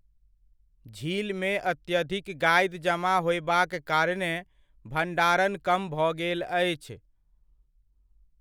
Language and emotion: Maithili, neutral